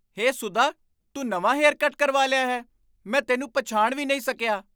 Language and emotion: Punjabi, surprised